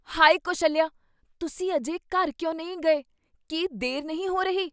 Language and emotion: Punjabi, surprised